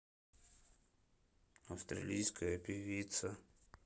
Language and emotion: Russian, sad